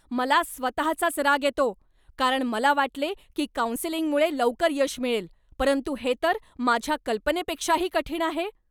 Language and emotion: Marathi, angry